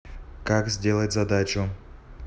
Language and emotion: Russian, neutral